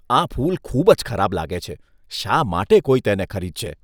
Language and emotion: Gujarati, disgusted